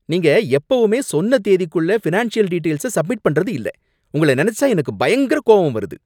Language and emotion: Tamil, angry